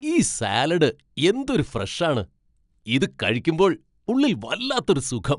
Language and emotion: Malayalam, happy